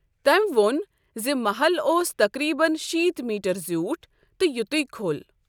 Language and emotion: Kashmiri, neutral